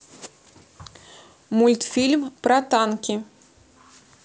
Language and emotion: Russian, neutral